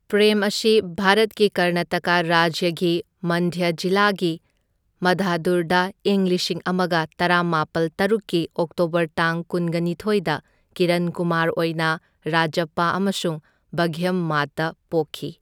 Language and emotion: Manipuri, neutral